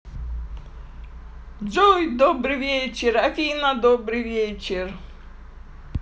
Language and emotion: Russian, positive